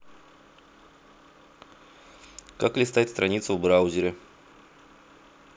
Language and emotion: Russian, neutral